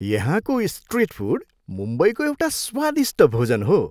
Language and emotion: Nepali, happy